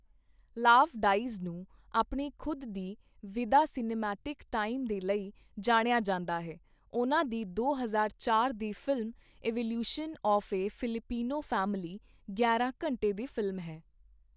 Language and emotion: Punjabi, neutral